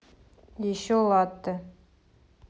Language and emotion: Russian, neutral